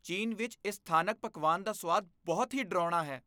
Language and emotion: Punjabi, disgusted